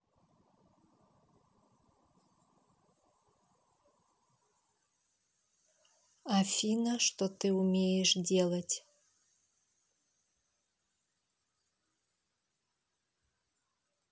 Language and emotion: Russian, neutral